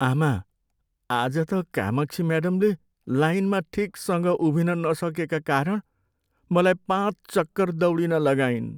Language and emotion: Nepali, sad